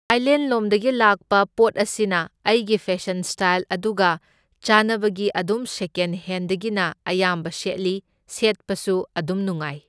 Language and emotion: Manipuri, neutral